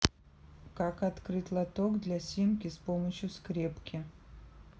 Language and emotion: Russian, neutral